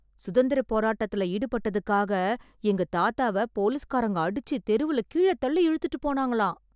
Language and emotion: Tamil, surprised